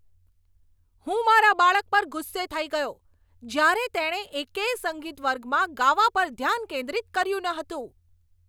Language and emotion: Gujarati, angry